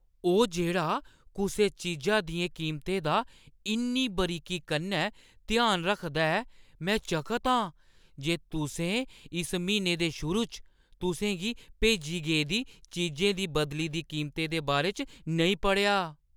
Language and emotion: Dogri, surprised